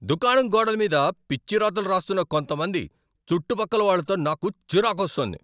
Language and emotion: Telugu, angry